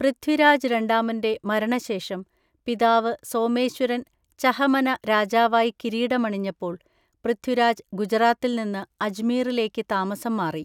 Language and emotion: Malayalam, neutral